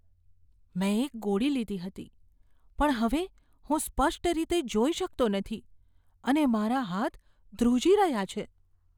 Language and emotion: Gujarati, fearful